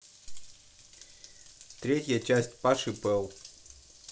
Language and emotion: Russian, neutral